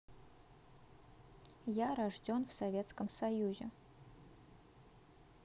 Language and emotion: Russian, neutral